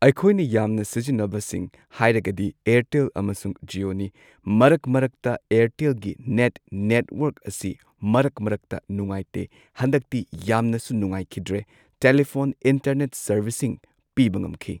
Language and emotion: Manipuri, neutral